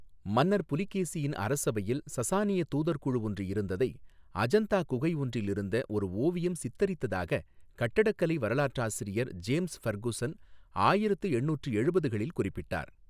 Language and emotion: Tamil, neutral